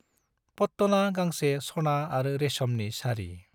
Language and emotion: Bodo, neutral